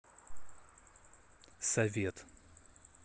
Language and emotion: Russian, neutral